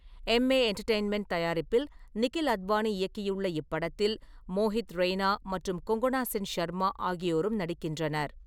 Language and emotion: Tamil, neutral